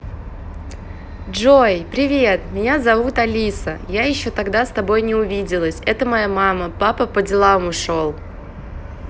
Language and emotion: Russian, positive